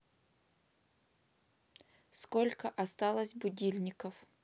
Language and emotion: Russian, neutral